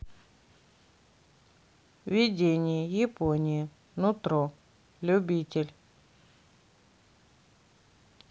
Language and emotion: Russian, neutral